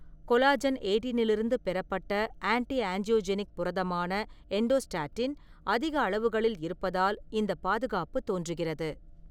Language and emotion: Tamil, neutral